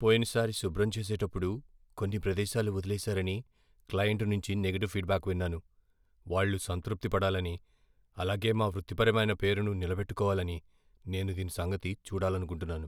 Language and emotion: Telugu, fearful